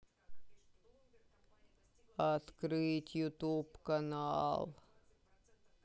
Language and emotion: Russian, sad